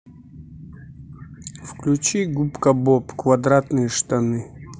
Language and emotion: Russian, neutral